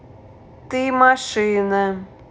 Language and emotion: Russian, neutral